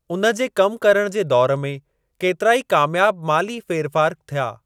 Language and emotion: Sindhi, neutral